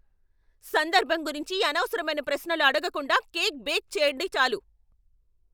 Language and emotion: Telugu, angry